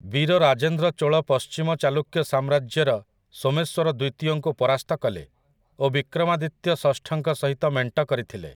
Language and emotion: Odia, neutral